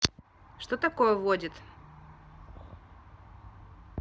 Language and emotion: Russian, neutral